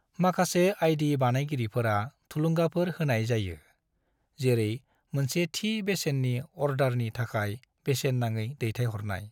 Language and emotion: Bodo, neutral